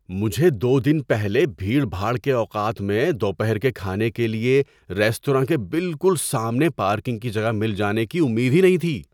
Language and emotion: Urdu, surprised